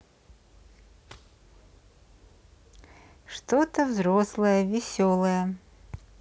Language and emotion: Russian, neutral